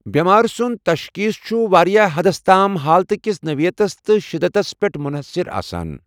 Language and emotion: Kashmiri, neutral